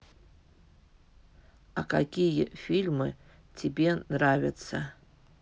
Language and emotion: Russian, neutral